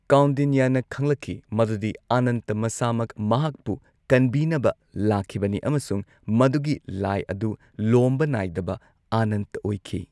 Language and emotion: Manipuri, neutral